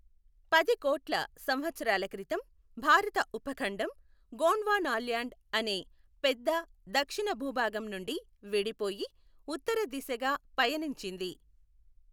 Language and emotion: Telugu, neutral